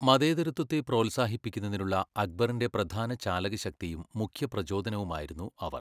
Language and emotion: Malayalam, neutral